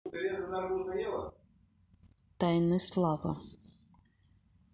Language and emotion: Russian, neutral